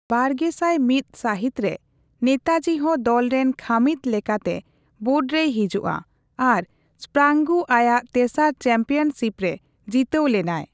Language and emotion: Santali, neutral